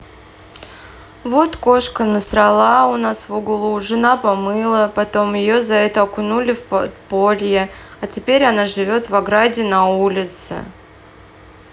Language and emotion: Russian, sad